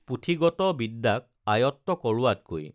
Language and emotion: Assamese, neutral